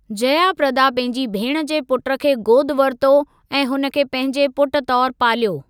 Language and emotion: Sindhi, neutral